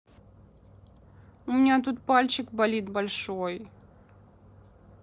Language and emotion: Russian, sad